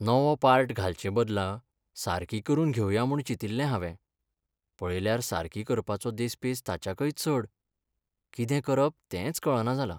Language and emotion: Goan Konkani, sad